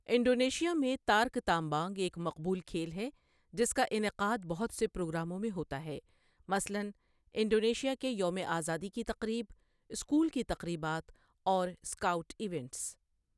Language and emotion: Urdu, neutral